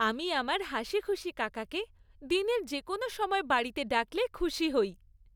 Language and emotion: Bengali, happy